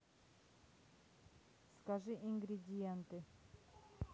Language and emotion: Russian, neutral